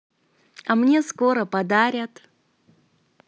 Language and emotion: Russian, positive